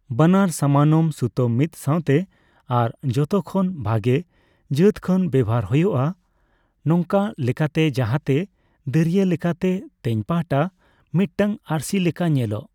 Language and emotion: Santali, neutral